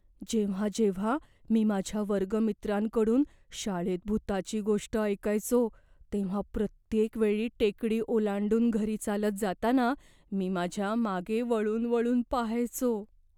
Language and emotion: Marathi, fearful